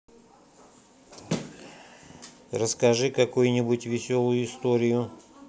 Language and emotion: Russian, neutral